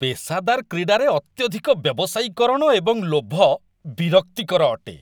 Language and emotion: Odia, disgusted